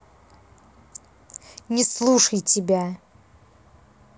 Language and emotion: Russian, angry